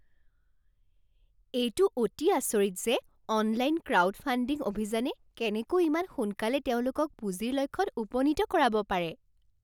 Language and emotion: Assamese, surprised